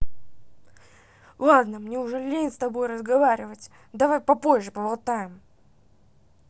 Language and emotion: Russian, angry